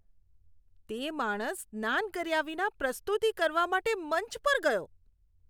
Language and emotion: Gujarati, disgusted